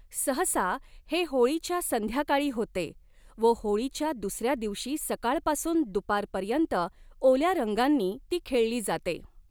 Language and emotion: Marathi, neutral